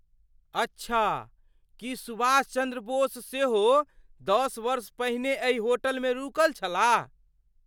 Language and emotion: Maithili, surprised